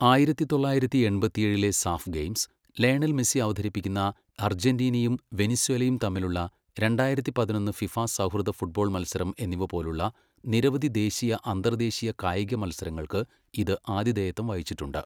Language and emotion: Malayalam, neutral